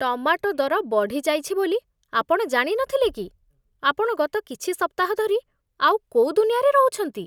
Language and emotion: Odia, disgusted